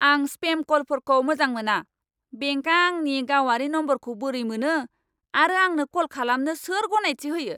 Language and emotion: Bodo, angry